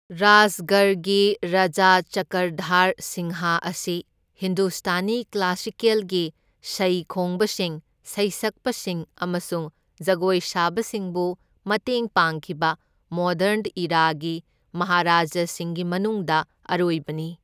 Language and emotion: Manipuri, neutral